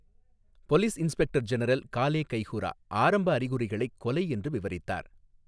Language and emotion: Tamil, neutral